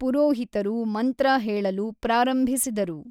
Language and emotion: Kannada, neutral